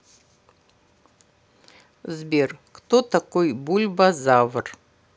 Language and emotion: Russian, neutral